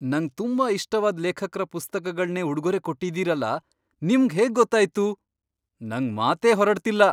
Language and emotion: Kannada, surprised